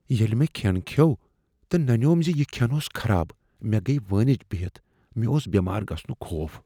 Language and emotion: Kashmiri, fearful